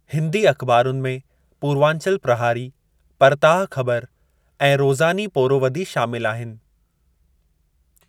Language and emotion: Sindhi, neutral